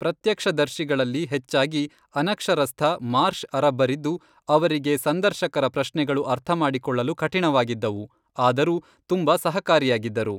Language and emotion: Kannada, neutral